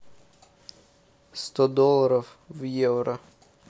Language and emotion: Russian, neutral